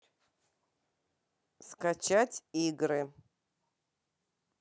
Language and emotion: Russian, neutral